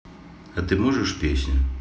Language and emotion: Russian, neutral